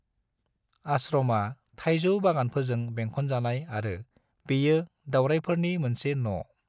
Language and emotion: Bodo, neutral